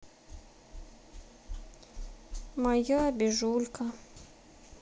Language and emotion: Russian, sad